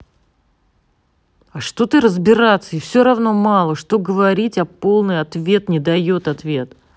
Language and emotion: Russian, angry